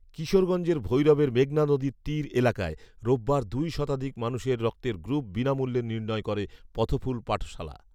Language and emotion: Bengali, neutral